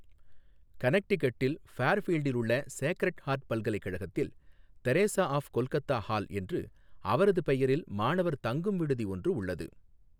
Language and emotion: Tamil, neutral